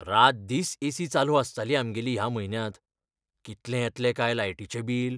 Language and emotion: Goan Konkani, fearful